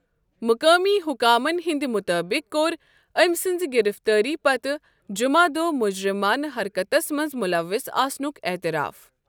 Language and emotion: Kashmiri, neutral